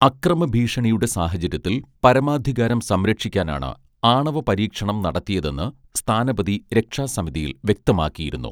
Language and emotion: Malayalam, neutral